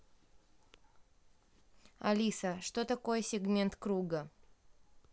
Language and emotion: Russian, neutral